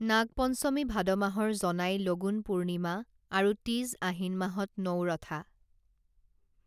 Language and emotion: Assamese, neutral